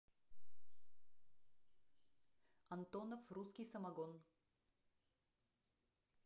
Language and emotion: Russian, neutral